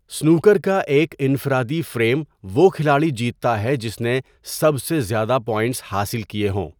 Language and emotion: Urdu, neutral